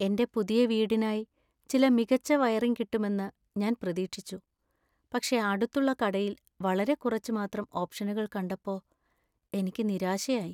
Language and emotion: Malayalam, sad